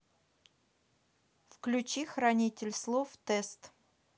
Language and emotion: Russian, neutral